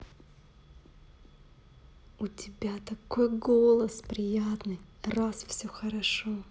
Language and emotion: Russian, positive